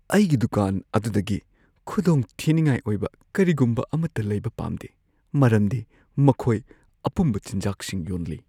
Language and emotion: Manipuri, fearful